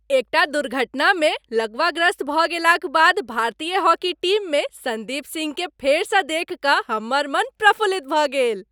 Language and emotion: Maithili, happy